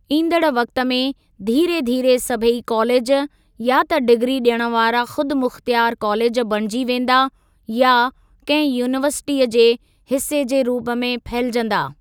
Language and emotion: Sindhi, neutral